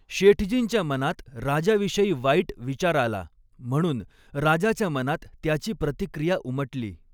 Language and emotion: Marathi, neutral